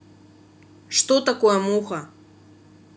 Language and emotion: Russian, neutral